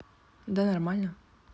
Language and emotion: Russian, neutral